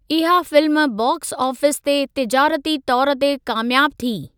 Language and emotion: Sindhi, neutral